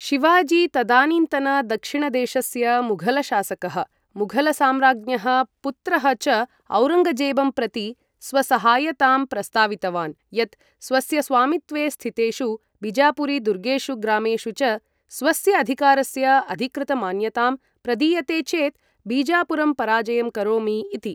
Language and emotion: Sanskrit, neutral